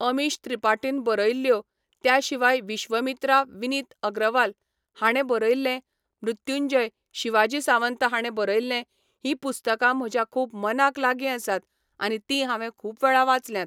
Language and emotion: Goan Konkani, neutral